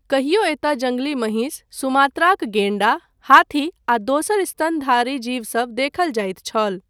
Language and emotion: Maithili, neutral